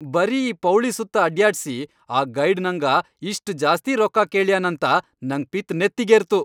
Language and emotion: Kannada, angry